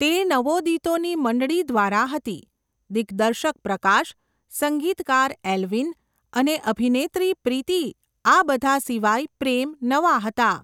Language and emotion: Gujarati, neutral